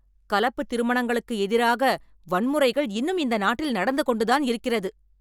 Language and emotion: Tamil, angry